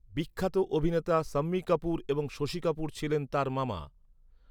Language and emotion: Bengali, neutral